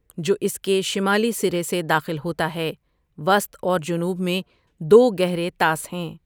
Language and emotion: Urdu, neutral